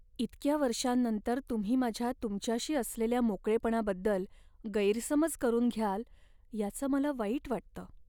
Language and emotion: Marathi, sad